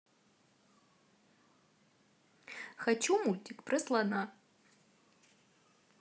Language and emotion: Russian, positive